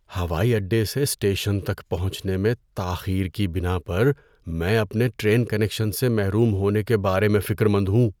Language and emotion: Urdu, fearful